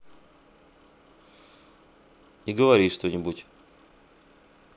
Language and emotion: Russian, neutral